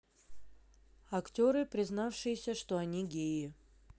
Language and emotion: Russian, neutral